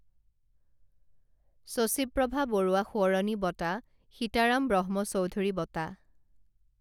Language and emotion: Assamese, neutral